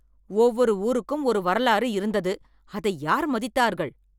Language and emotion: Tamil, angry